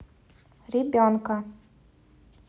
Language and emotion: Russian, neutral